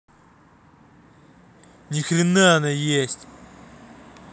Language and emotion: Russian, angry